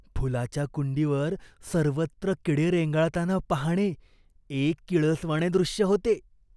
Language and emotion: Marathi, disgusted